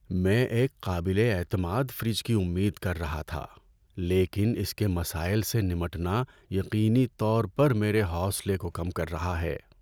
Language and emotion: Urdu, sad